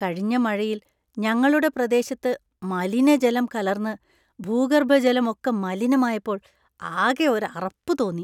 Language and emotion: Malayalam, disgusted